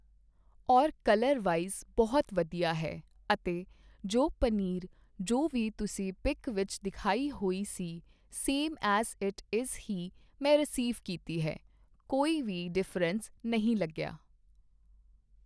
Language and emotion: Punjabi, neutral